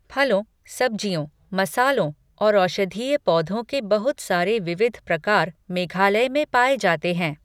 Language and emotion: Hindi, neutral